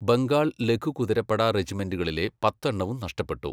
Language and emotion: Malayalam, neutral